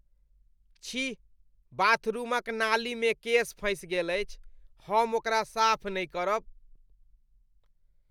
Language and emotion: Maithili, disgusted